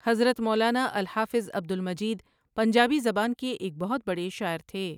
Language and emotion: Urdu, neutral